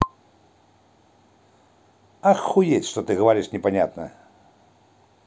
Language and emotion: Russian, positive